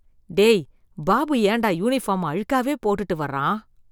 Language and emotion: Tamil, disgusted